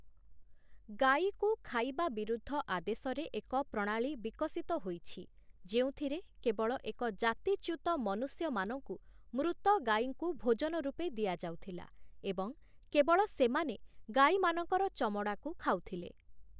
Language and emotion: Odia, neutral